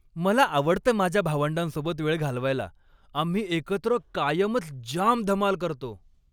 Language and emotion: Marathi, happy